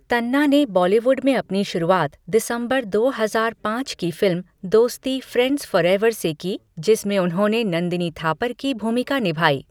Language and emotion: Hindi, neutral